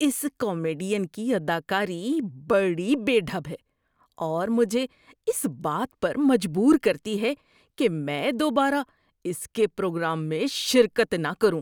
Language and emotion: Urdu, disgusted